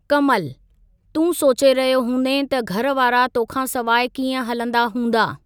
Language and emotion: Sindhi, neutral